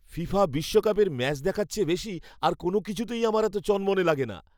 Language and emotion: Bengali, happy